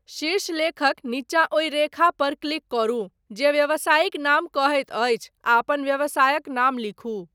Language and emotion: Maithili, neutral